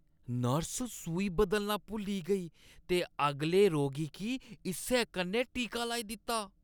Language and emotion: Dogri, disgusted